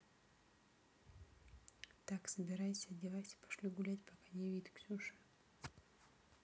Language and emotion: Russian, neutral